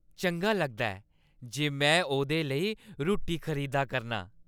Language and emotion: Dogri, happy